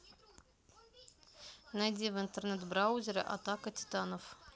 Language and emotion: Russian, neutral